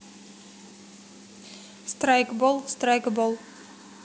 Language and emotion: Russian, neutral